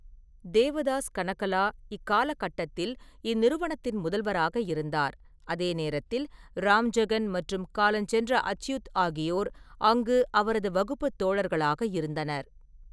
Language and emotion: Tamil, neutral